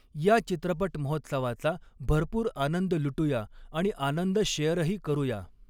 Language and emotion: Marathi, neutral